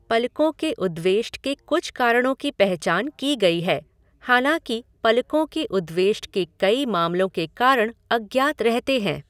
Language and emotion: Hindi, neutral